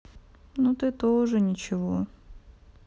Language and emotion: Russian, sad